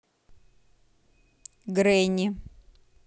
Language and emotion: Russian, neutral